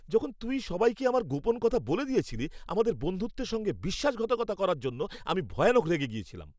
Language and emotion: Bengali, angry